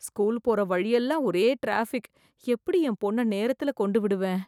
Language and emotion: Tamil, fearful